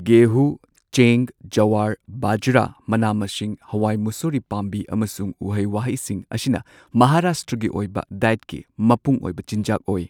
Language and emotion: Manipuri, neutral